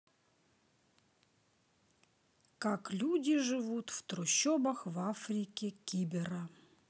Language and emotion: Russian, neutral